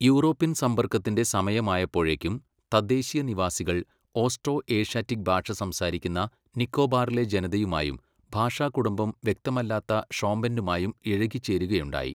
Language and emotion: Malayalam, neutral